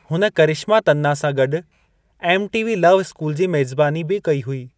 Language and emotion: Sindhi, neutral